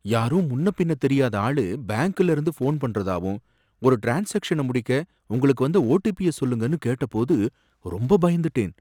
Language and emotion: Tamil, fearful